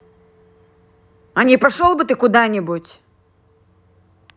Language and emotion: Russian, angry